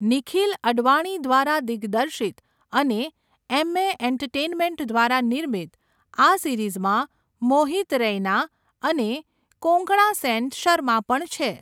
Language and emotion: Gujarati, neutral